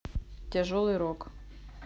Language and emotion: Russian, neutral